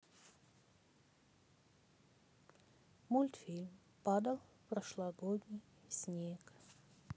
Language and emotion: Russian, sad